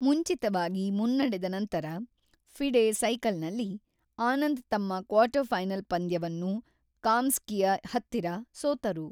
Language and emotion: Kannada, neutral